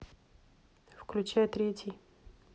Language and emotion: Russian, neutral